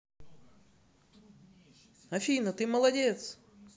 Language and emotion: Russian, positive